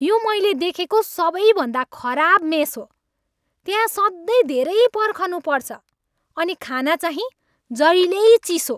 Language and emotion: Nepali, angry